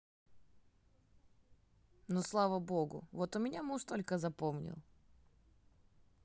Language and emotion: Russian, neutral